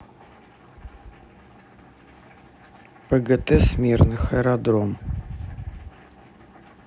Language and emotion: Russian, neutral